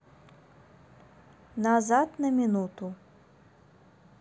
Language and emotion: Russian, neutral